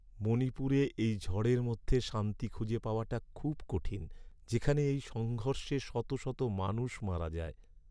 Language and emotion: Bengali, sad